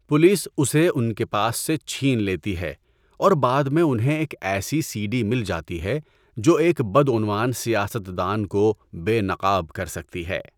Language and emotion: Urdu, neutral